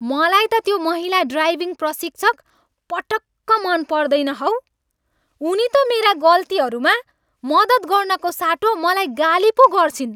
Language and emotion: Nepali, angry